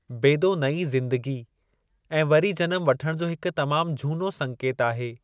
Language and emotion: Sindhi, neutral